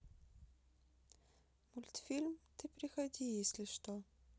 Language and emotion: Russian, sad